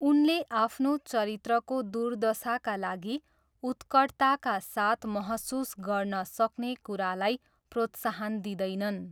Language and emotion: Nepali, neutral